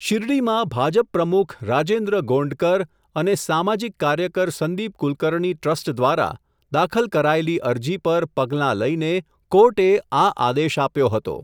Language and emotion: Gujarati, neutral